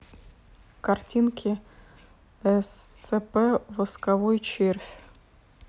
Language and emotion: Russian, neutral